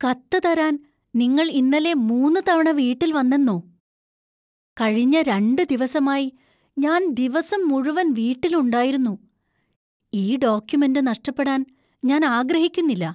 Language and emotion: Malayalam, fearful